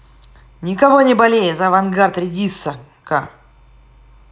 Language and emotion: Russian, positive